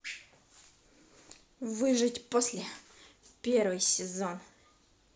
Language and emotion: Russian, angry